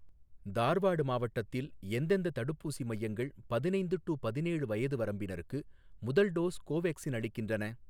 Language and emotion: Tamil, neutral